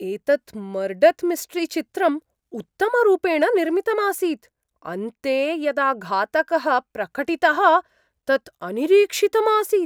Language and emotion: Sanskrit, surprised